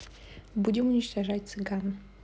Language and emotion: Russian, neutral